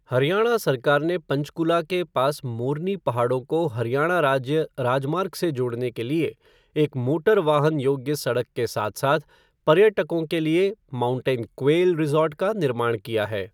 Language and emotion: Hindi, neutral